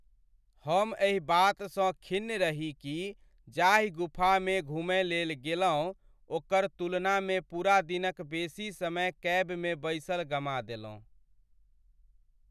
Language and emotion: Maithili, sad